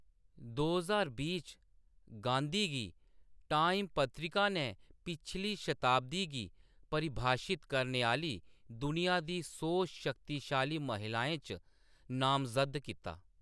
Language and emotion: Dogri, neutral